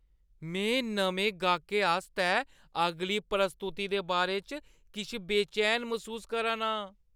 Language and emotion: Dogri, fearful